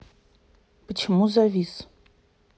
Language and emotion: Russian, neutral